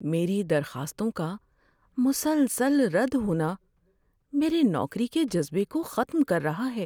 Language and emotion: Urdu, sad